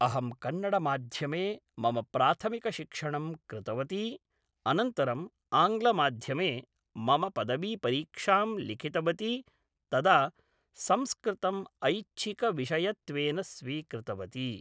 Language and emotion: Sanskrit, neutral